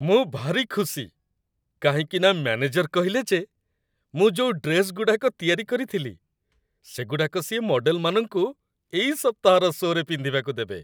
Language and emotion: Odia, happy